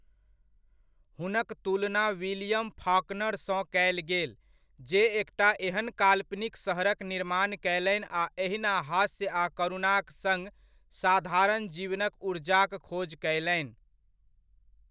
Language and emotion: Maithili, neutral